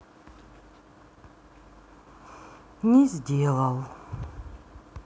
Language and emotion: Russian, sad